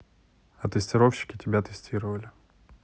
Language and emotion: Russian, neutral